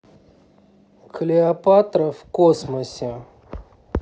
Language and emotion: Russian, neutral